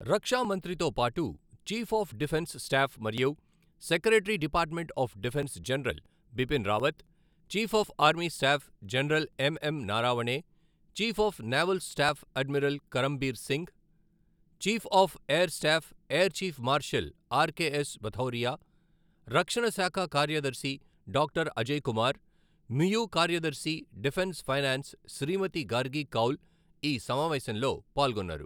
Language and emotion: Telugu, neutral